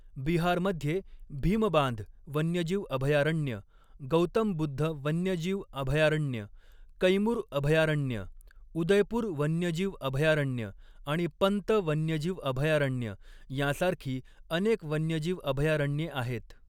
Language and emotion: Marathi, neutral